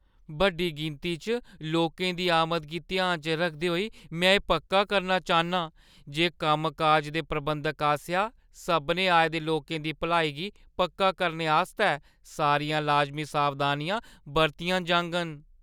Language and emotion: Dogri, fearful